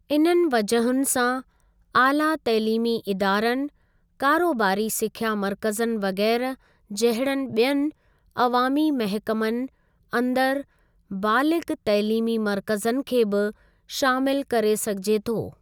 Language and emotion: Sindhi, neutral